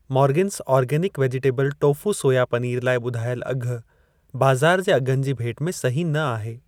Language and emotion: Sindhi, neutral